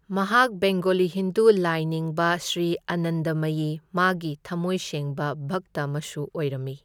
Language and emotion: Manipuri, neutral